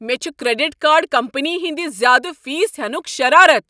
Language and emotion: Kashmiri, angry